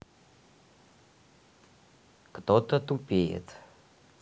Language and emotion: Russian, neutral